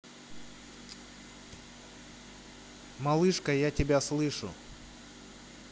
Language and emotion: Russian, neutral